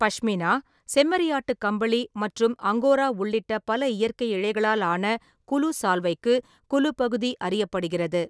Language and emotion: Tamil, neutral